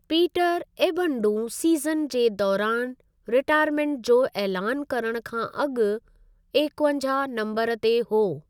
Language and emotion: Sindhi, neutral